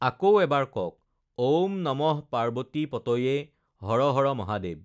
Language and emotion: Assamese, neutral